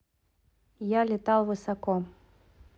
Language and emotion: Russian, neutral